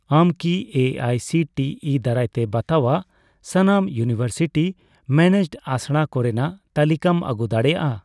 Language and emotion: Santali, neutral